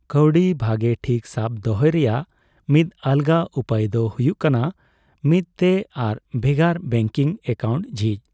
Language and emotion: Santali, neutral